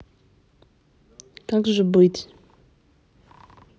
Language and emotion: Russian, sad